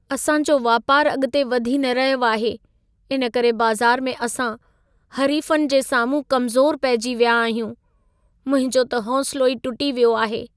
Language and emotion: Sindhi, sad